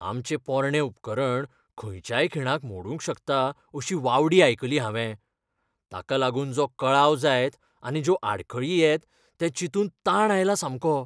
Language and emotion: Goan Konkani, fearful